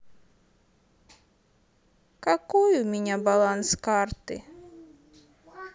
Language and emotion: Russian, sad